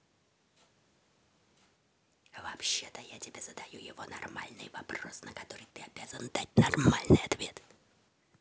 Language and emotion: Russian, angry